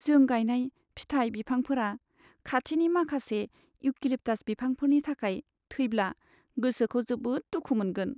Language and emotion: Bodo, sad